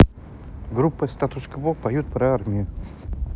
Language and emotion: Russian, neutral